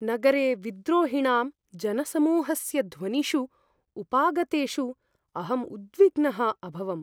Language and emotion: Sanskrit, fearful